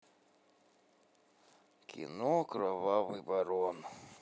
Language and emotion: Russian, neutral